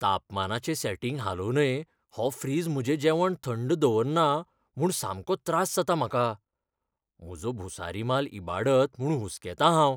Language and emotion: Goan Konkani, fearful